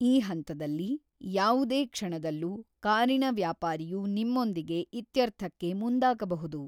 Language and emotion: Kannada, neutral